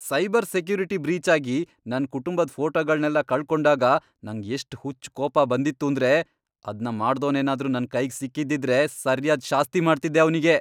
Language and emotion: Kannada, angry